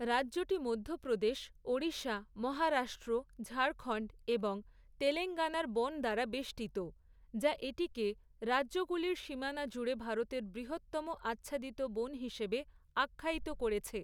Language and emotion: Bengali, neutral